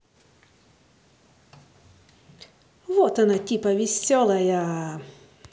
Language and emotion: Russian, positive